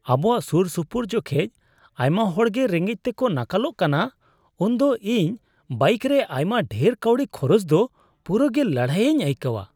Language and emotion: Santali, disgusted